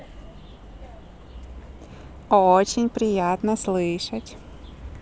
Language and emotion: Russian, positive